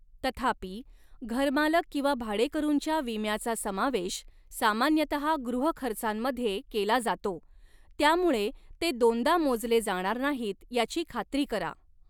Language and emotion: Marathi, neutral